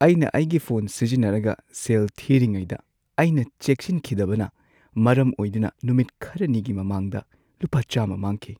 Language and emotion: Manipuri, sad